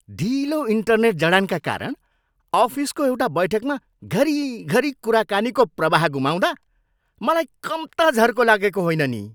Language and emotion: Nepali, angry